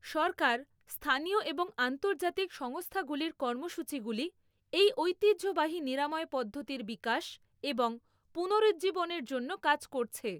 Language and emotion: Bengali, neutral